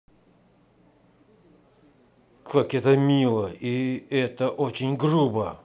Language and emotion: Russian, angry